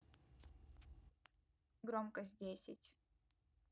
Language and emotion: Russian, neutral